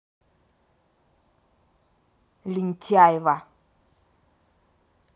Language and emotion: Russian, angry